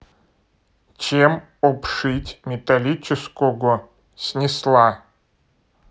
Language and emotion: Russian, neutral